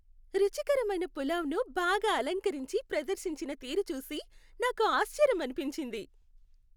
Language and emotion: Telugu, happy